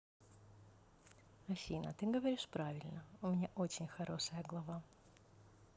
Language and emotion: Russian, positive